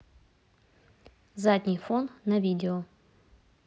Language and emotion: Russian, neutral